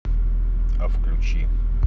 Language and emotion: Russian, neutral